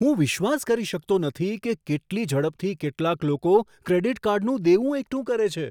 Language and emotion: Gujarati, surprised